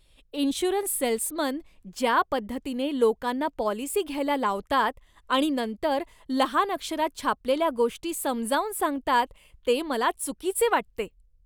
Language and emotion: Marathi, disgusted